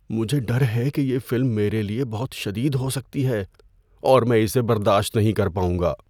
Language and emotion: Urdu, fearful